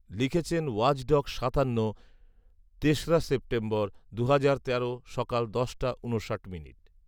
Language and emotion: Bengali, neutral